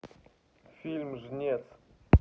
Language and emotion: Russian, neutral